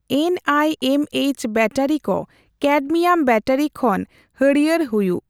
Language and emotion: Santali, neutral